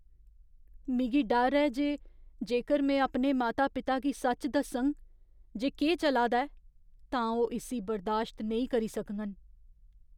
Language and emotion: Dogri, fearful